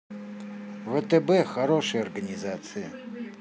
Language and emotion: Russian, neutral